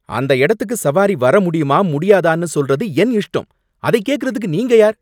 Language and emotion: Tamil, angry